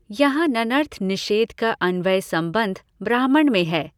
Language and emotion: Hindi, neutral